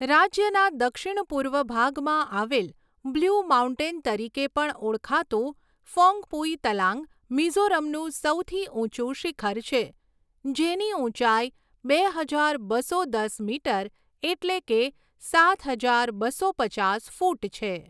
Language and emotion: Gujarati, neutral